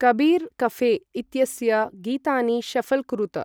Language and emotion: Sanskrit, neutral